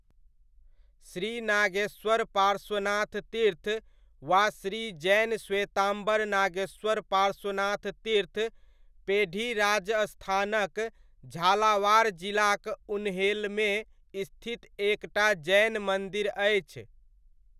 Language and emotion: Maithili, neutral